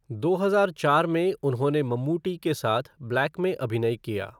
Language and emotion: Hindi, neutral